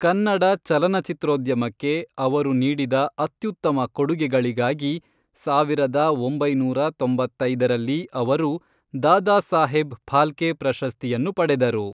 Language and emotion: Kannada, neutral